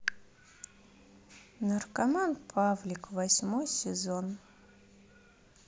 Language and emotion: Russian, sad